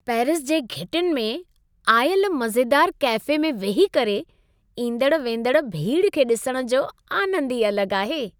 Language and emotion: Sindhi, happy